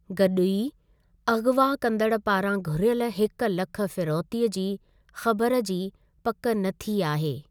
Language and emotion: Sindhi, neutral